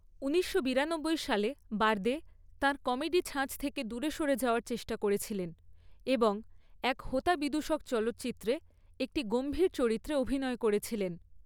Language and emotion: Bengali, neutral